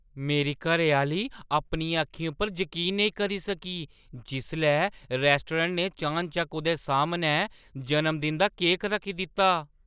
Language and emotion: Dogri, surprised